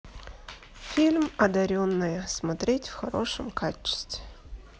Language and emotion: Russian, neutral